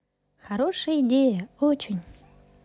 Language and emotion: Russian, positive